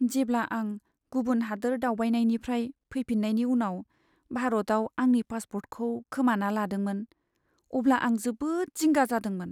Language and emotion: Bodo, sad